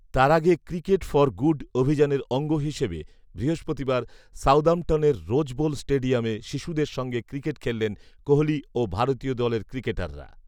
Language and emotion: Bengali, neutral